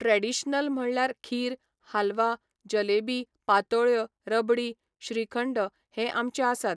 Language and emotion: Goan Konkani, neutral